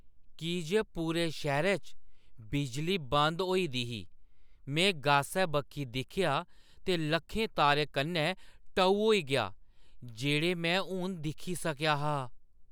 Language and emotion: Dogri, surprised